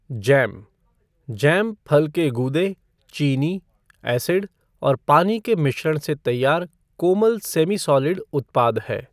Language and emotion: Hindi, neutral